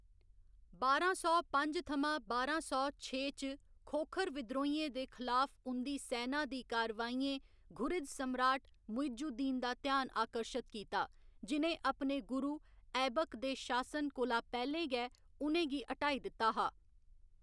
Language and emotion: Dogri, neutral